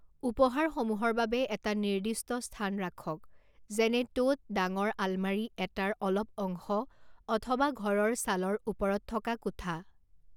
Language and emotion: Assamese, neutral